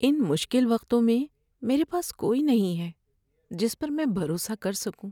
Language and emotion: Urdu, sad